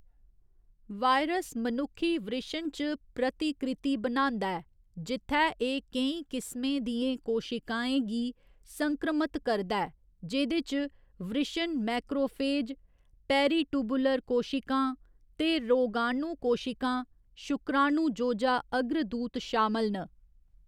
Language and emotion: Dogri, neutral